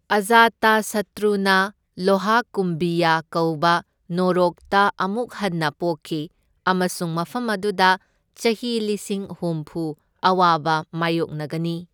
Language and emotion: Manipuri, neutral